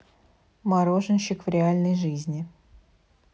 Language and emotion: Russian, neutral